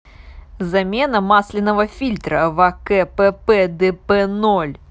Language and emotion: Russian, neutral